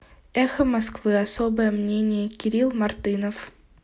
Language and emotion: Russian, neutral